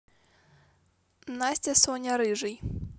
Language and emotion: Russian, neutral